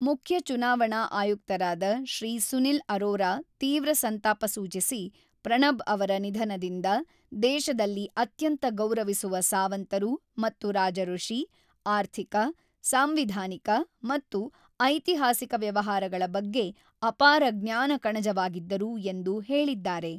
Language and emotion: Kannada, neutral